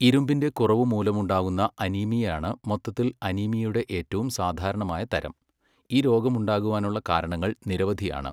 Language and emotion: Malayalam, neutral